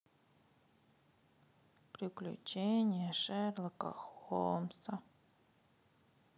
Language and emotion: Russian, sad